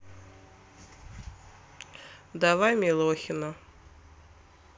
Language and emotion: Russian, neutral